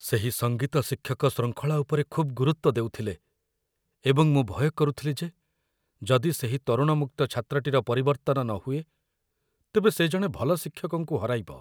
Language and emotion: Odia, fearful